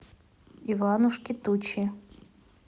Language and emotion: Russian, neutral